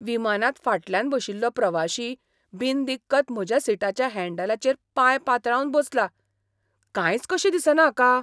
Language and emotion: Goan Konkani, surprised